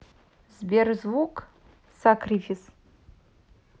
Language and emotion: Russian, neutral